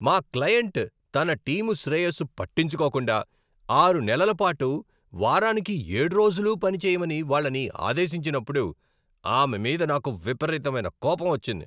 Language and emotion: Telugu, angry